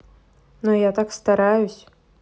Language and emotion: Russian, neutral